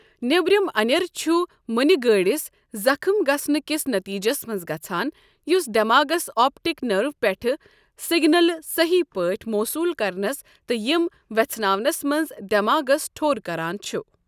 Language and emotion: Kashmiri, neutral